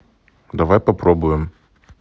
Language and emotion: Russian, neutral